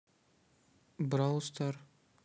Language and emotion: Russian, neutral